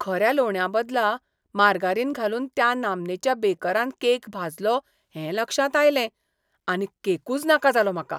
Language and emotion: Goan Konkani, disgusted